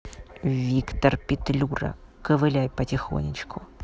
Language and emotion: Russian, angry